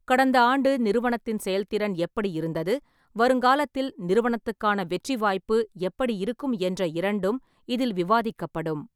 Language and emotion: Tamil, neutral